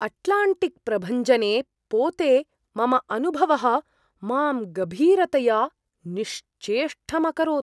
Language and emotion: Sanskrit, surprised